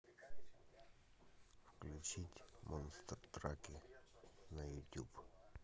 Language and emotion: Russian, neutral